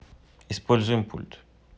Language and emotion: Russian, neutral